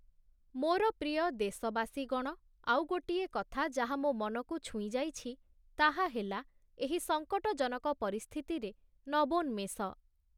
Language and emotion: Odia, neutral